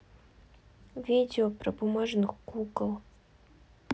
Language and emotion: Russian, neutral